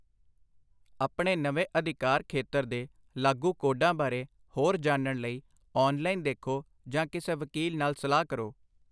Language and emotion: Punjabi, neutral